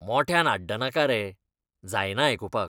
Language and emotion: Goan Konkani, disgusted